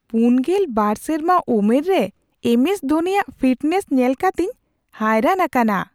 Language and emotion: Santali, surprised